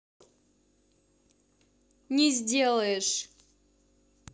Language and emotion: Russian, angry